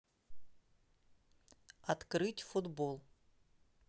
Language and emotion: Russian, neutral